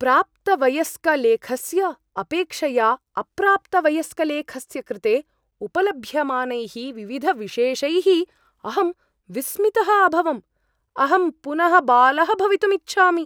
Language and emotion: Sanskrit, surprised